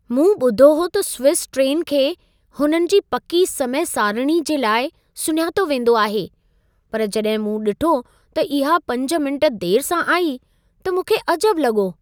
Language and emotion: Sindhi, surprised